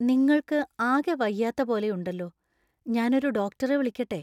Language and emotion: Malayalam, fearful